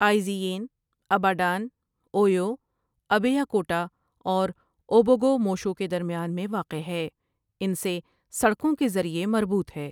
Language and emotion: Urdu, neutral